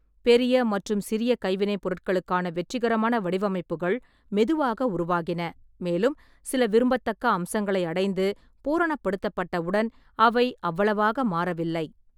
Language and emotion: Tamil, neutral